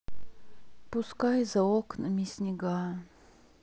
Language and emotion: Russian, sad